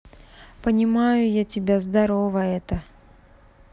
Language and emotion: Russian, neutral